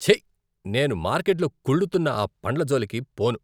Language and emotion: Telugu, disgusted